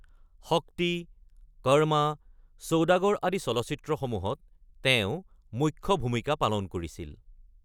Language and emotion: Assamese, neutral